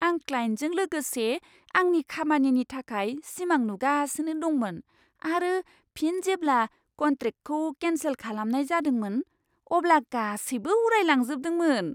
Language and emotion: Bodo, surprised